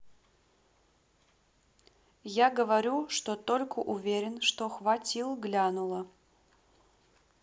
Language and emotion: Russian, neutral